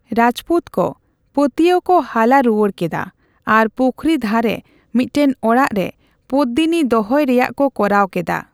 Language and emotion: Santali, neutral